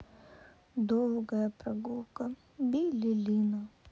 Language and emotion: Russian, sad